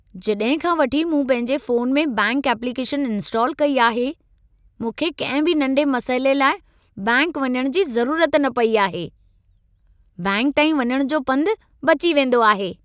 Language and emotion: Sindhi, happy